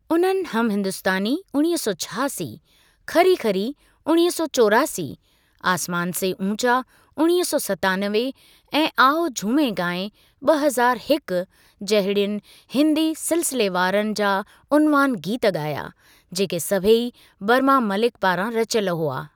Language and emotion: Sindhi, neutral